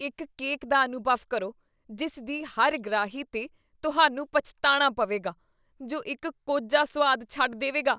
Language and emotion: Punjabi, disgusted